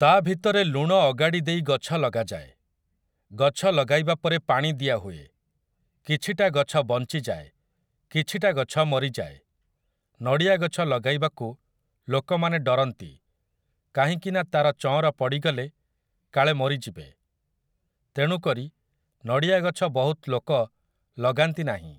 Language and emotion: Odia, neutral